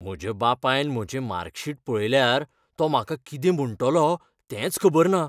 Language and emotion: Goan Konkani, fearful